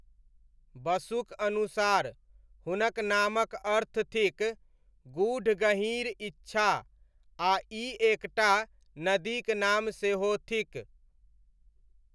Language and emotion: Maithili, neutral